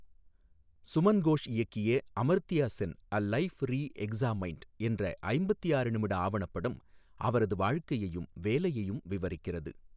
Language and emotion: Tamil, neutral